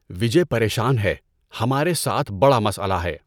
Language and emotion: Urdu, neutral